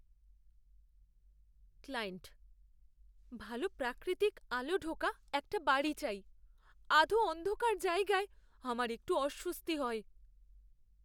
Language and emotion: Bengali, fearful